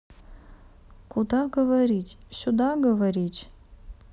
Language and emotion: Russian, neutral